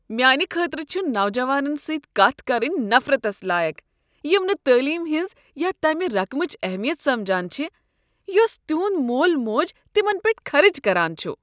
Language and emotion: Kashmiri, disgusted